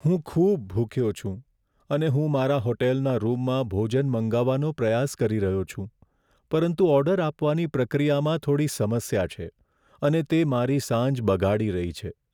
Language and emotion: Gujarati, sad